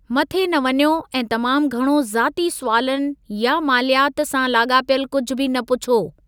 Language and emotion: Sindhi, neutral